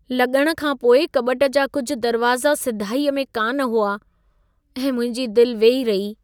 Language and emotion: Sindhi, sad